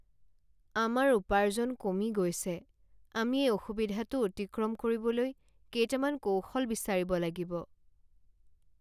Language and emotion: Assamese, sad